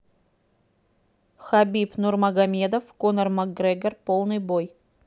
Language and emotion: Russian, neutral